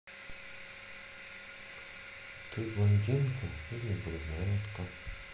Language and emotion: Russian, sad